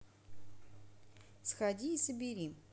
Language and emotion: Russian, neutral